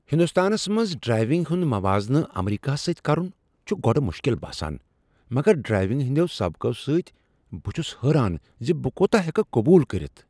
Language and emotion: Kashmiri, surprised